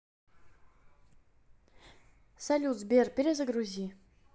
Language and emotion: Russian, neutral